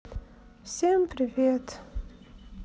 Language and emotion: Russian, sad